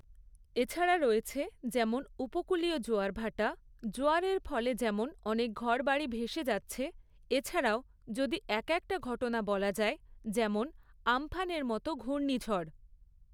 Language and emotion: Bengali, neutral